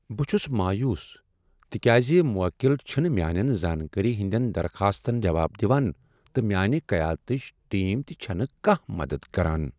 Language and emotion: Kashmiri, sad